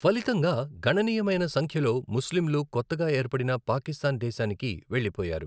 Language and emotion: Telugu, neutral